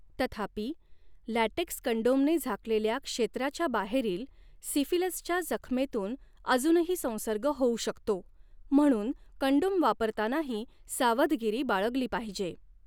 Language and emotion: Marathi, neutral